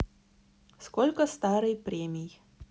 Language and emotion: Russian, neutral